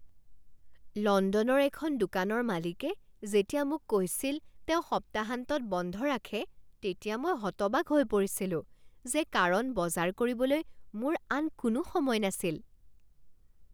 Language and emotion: Assamese, surprised